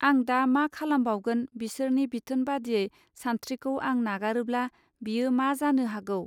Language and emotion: Bodo, neutral